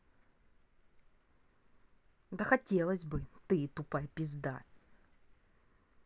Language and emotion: Russian, angry